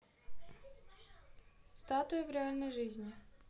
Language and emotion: Russian, neutral